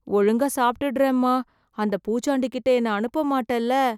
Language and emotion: Tamil, fearful